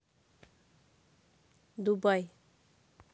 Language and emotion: Russian, neutral